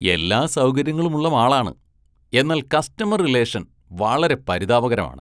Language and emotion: Malayalam, disgusted